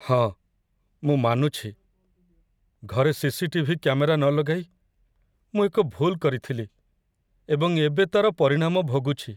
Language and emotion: Odia, sad